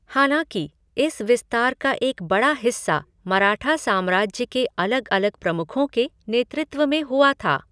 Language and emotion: Hindi, neutral